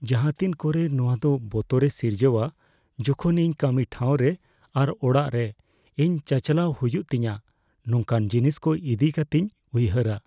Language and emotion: Santali, fearful